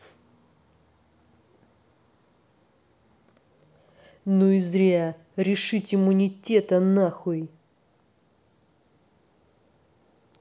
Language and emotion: Russian, angry